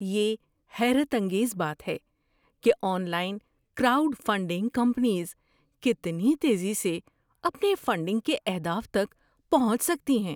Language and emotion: Urdu, surprised